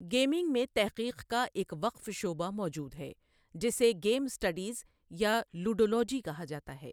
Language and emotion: Urdu, neutral